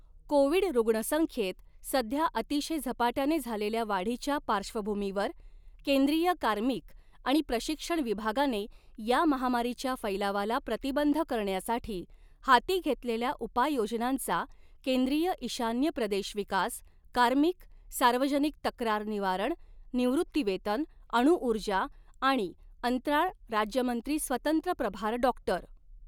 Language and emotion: Marathi, neutral